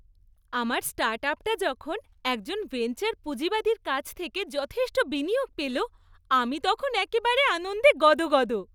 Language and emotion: Bengali, happy